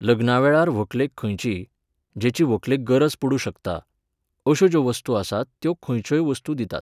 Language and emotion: Goan Konkani, neutral